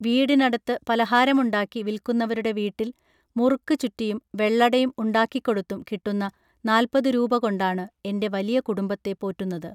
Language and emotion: Malayalam, neutral